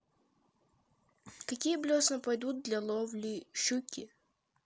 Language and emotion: Russian, neutral